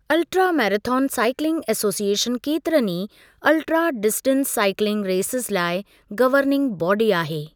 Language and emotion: Sindhi, neutral